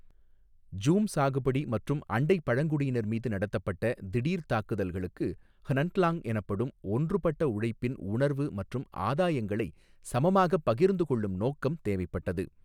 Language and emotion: Tamil, neutral